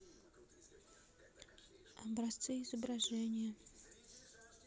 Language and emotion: Russian, neutral